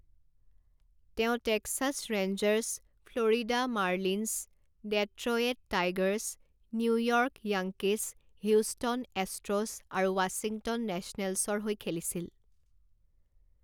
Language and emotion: Assamese, neutral